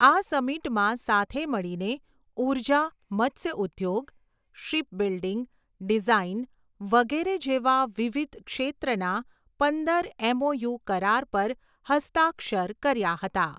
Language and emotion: Gujarati, neutral